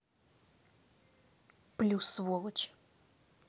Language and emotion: Russian, angry